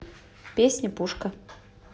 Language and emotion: Russian, neutral